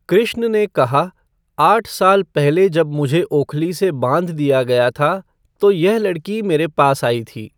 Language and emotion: Hindi, neutral